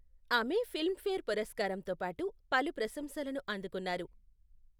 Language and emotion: Telugu, neutral